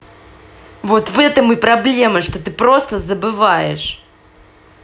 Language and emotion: Russian, angry